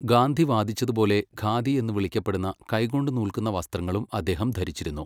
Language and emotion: Malayalam, neutral